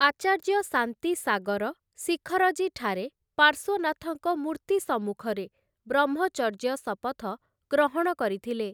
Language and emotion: Odia, neutral